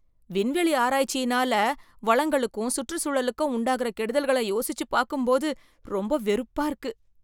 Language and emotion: Tamil, disgusted